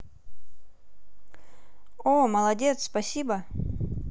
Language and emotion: Russian, positive